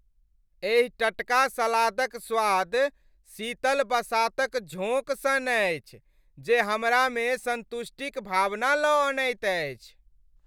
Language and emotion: Maithili, happy